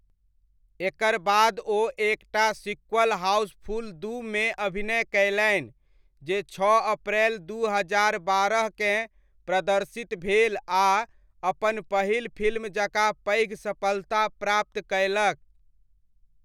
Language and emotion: Maithili, neutral